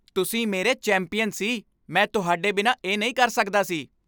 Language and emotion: Punjabi, happy